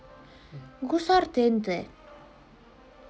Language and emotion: Russian, neutral